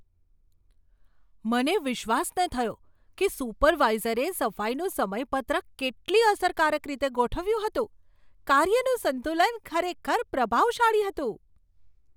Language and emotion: Gujarati, surprised